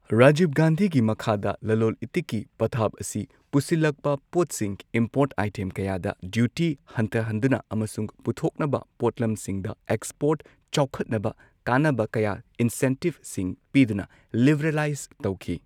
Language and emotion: Manipuri, neutral